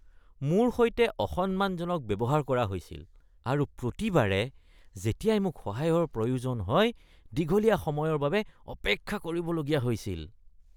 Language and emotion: Assamese, disgusted